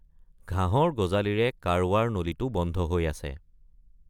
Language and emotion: Assamese, neutral